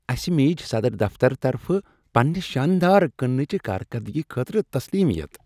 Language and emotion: Kashmiri, happy